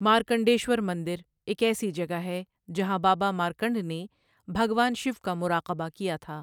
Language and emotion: Urdu, neutral